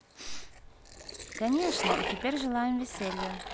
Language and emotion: Russian, positive